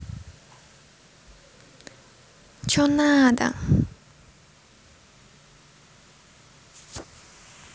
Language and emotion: Russian, angry